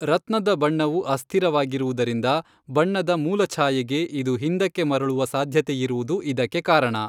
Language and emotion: Kannada, neutral